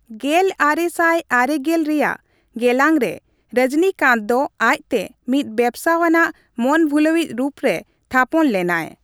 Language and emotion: Santali, neutral